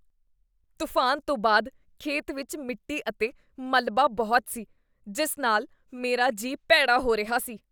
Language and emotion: Punjabi, disgusted